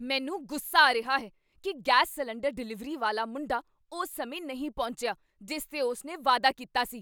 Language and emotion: Punjabi, angry